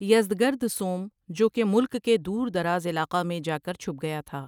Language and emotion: Urdu, neutral